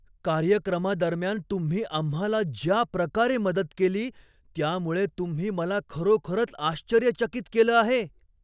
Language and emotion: Marathi, surprised